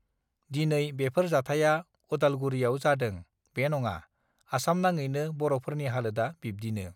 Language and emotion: Bodo, neutral